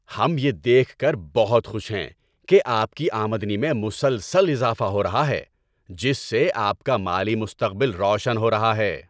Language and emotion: Urdu, happy